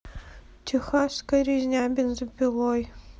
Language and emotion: Russian, sad